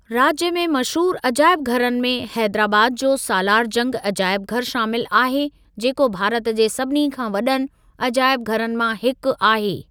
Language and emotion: Sindhi, neutral